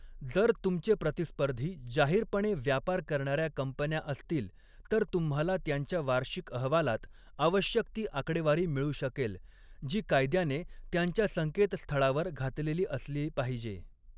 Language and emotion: Marathi, neutral